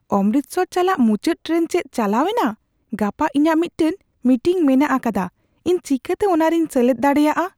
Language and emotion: Santali, fearful